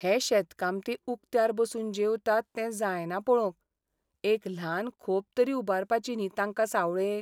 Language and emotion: Goan Konkani, sad